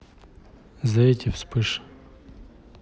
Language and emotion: Russian, neutral